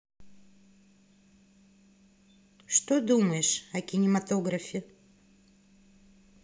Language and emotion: Russian, neutral